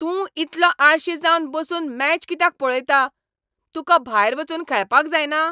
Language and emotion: Goan Konkani, angry